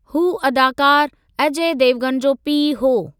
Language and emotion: Sindhi, neutral